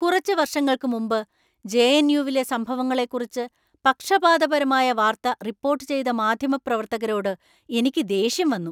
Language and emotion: Malayalam, angry